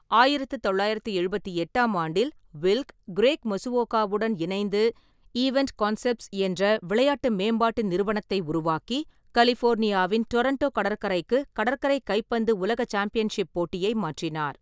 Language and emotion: Tamil, neutral